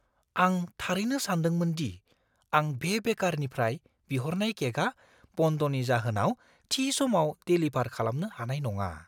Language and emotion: Bodo, fearful